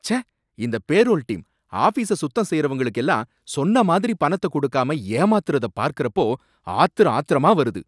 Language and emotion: Tamil, angry